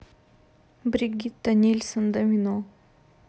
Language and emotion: Russian, neutral